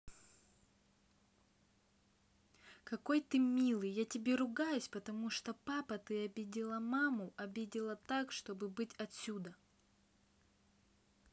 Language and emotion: Russian, neutral